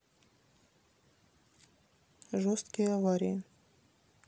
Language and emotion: Russian, neutral